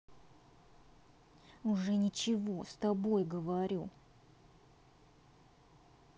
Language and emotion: Russian, angry